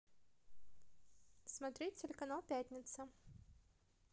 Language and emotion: Russian, positive